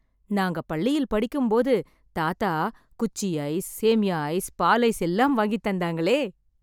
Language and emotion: Tamil, happy